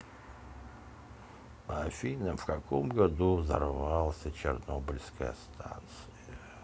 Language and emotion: Russian, neutral